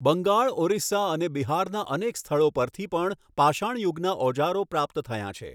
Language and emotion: Gujarati, neutral